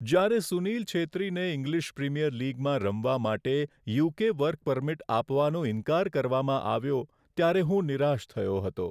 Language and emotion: Gujarati, sad